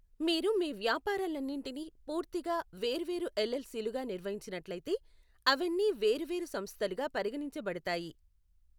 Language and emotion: Telugu, neutral